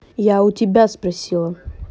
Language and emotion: Russian, angry